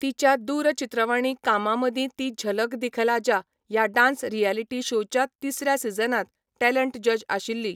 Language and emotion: Goan Konkani, neutral